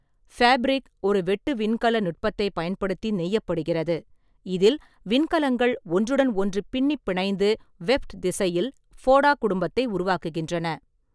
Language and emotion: Tamil, neutral